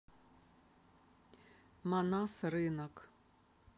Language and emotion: Russian, neutral